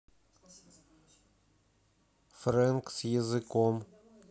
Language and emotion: Russian, neutral